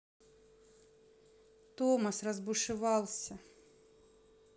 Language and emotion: Russian, neutral